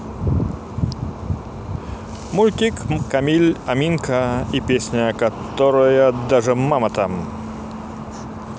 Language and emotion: Russian, positive